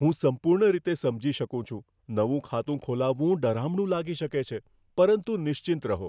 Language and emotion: Gujarati, fearful